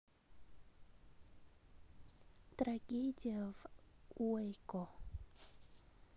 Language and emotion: Russian, neutral